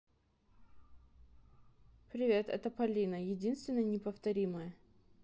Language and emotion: Russian, neutral